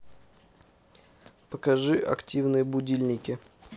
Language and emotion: Russian, neutral